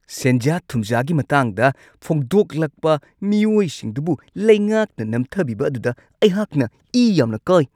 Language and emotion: Manipuri, angry